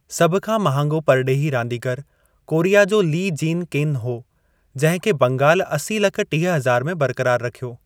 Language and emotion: Sindhi, neutral